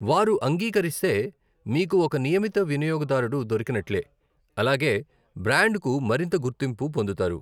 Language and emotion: Telugu, neutral